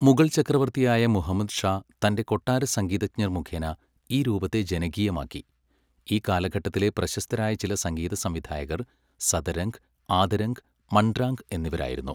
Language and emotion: Malayalam, neutral